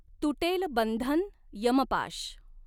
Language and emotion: Marathi, neutral